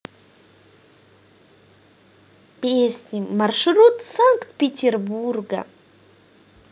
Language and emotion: Russian, positive